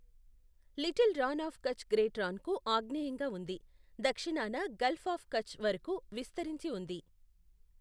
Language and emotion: Telugu, neutral